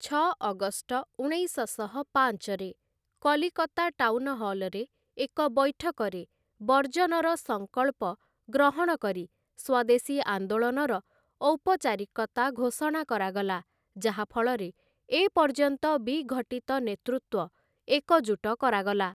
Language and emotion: Odia, neutral